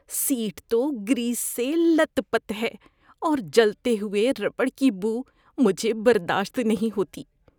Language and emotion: Urdu, disgusted